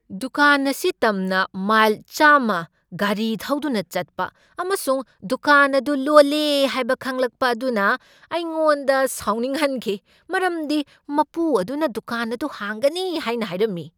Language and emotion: Manipuri, angry